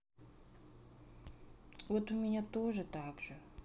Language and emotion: Russian, sad